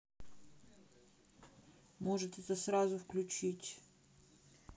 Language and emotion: Russian, neutral